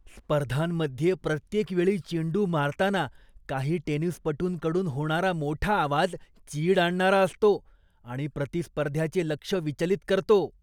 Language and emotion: Marathi, disgusted